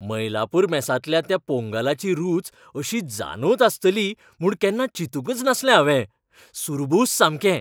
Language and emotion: Goan Konkani, happy